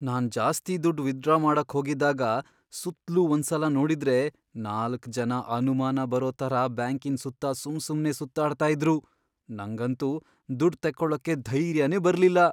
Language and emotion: Kannada, fearful